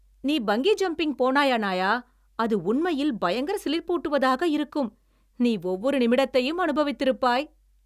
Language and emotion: Tamil, happy